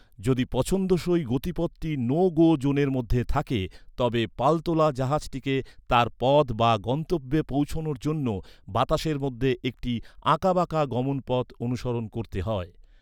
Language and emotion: Bengali, neutral